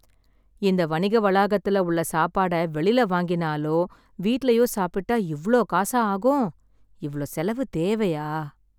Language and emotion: Tamil, sad